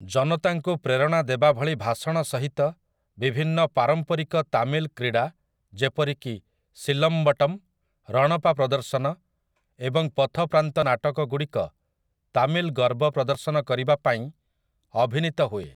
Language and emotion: Odia, neutral